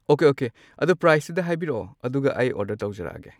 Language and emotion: Manipuri, neutral